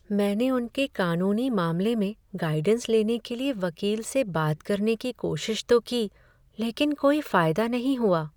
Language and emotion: Hindi, sad